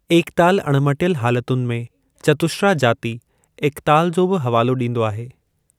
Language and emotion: Sindhi, neutral